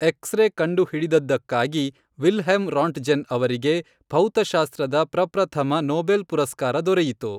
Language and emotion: Kannada, neutral